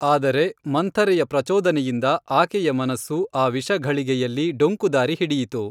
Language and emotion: Kannada, neutral